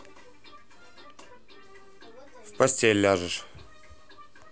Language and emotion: Russian, neutral